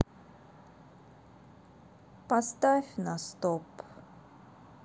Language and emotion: Russian, sad